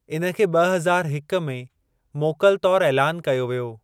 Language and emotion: Sindhi, neutral